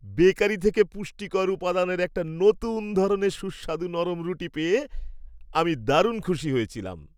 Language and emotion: Bengali, happy